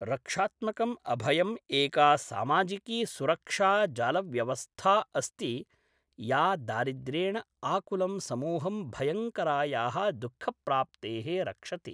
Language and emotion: Sanskrit, neutral